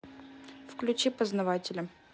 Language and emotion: Russian, neutral